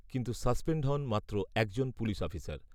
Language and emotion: Bengali, neutral